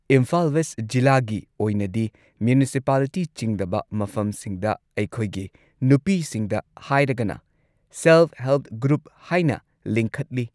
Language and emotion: Manipuri, neutral